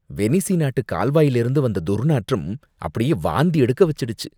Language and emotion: Tamil, disgusted